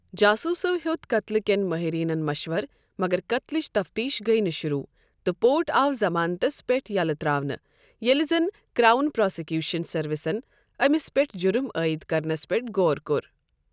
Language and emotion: Kashmiri, neutral